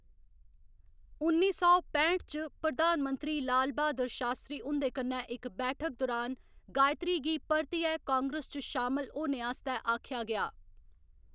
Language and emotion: Dogri, neutral